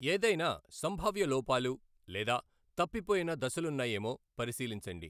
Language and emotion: Telugu, neutral